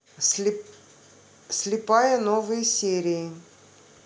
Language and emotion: Russian, neutral